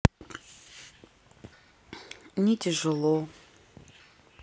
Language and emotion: Russian, sad